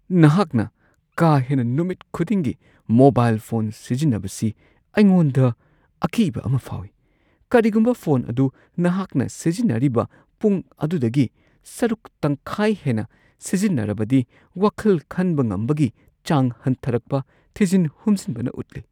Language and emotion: Manipuri, fearful